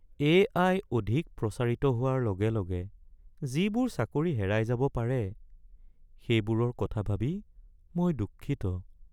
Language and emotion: Assamese, sad